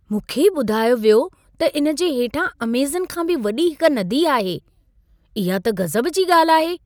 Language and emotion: Sindhi, surprised